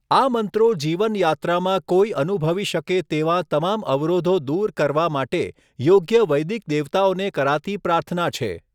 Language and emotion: Gujarati, neutral